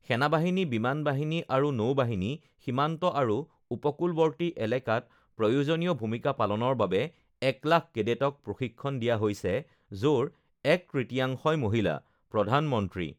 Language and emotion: Assamese, neutral